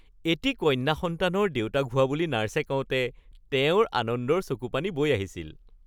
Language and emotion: Assamese, happy